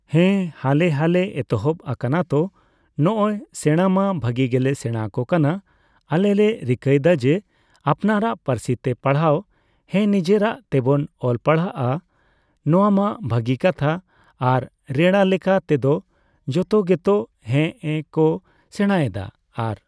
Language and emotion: Santali, neutral